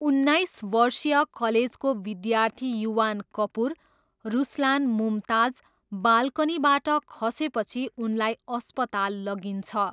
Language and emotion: Nepali, neutral